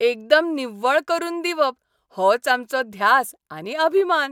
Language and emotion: Goan Konkani, happy